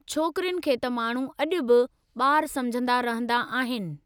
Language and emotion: Sindhi, neutral